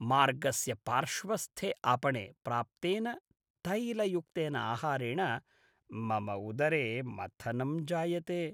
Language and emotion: Sanskrit, disgusted